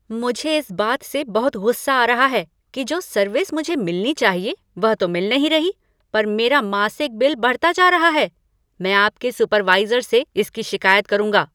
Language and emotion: Hindi, angry